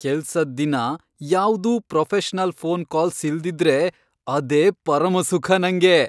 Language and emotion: Kannada, happy